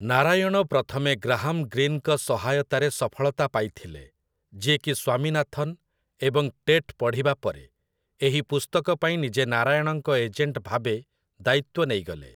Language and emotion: Odia, neutral